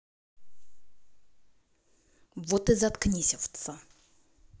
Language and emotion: Russian, angry